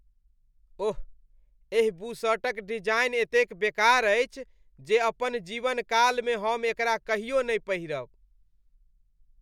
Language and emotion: Maithili, disgusted